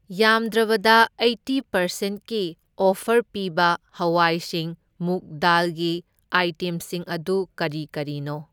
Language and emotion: Manipuri, neutral